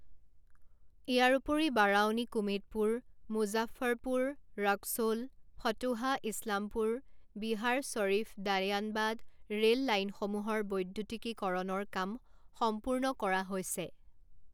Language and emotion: Assamese, neutral